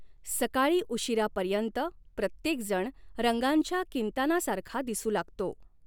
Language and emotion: Marathi, neutral